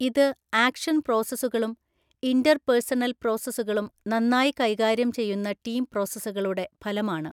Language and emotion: Malayalam, neutral